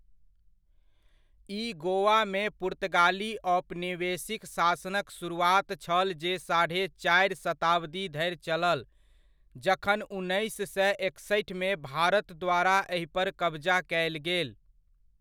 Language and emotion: Maithili, neutral